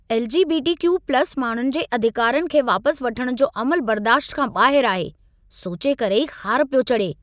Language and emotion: Sindhi, angry